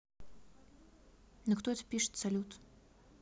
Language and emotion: Russian, neutral